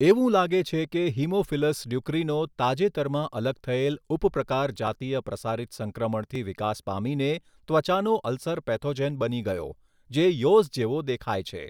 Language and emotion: Gujarati, neutral